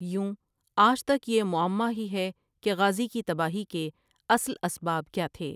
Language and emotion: Urdu, neutral